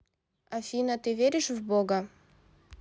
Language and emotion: Russian, neutral